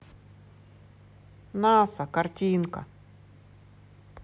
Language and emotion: Russian, neutral